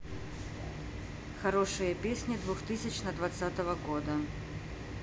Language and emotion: Russian, neutral